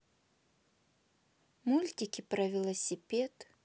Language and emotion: Russian, neutral